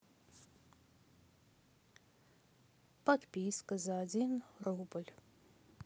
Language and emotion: Russian, sad